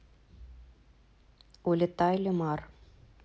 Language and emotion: Russian, neutral